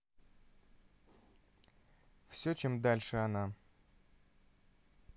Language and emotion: Russian, neutral